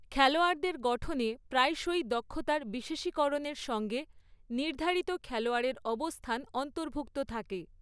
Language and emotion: Bengali, neutral